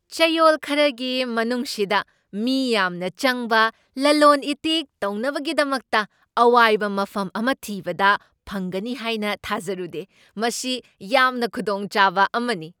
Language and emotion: Manipuri, surprised